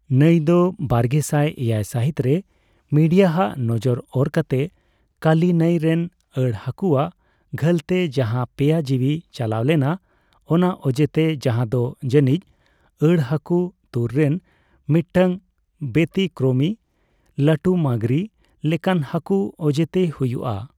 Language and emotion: Santali, neutral